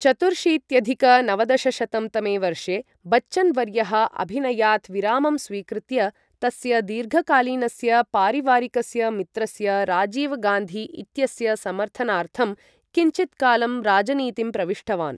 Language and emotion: Sanskrit, neutral